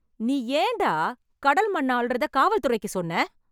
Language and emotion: Tamil, angry